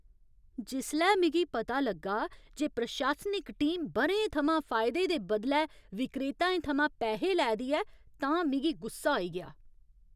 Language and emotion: Dogri, angry